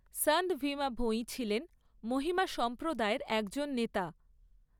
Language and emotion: Bengali, neutral